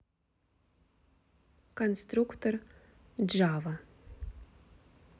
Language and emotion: Russian, neutral